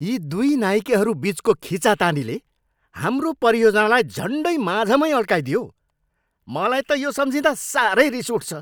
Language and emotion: Nepali, angry